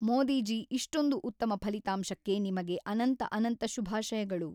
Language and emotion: Kannada, neutral